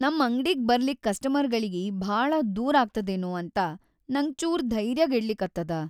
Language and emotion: Kannada, sad